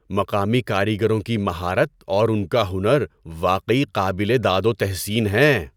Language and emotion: Urdu, surprised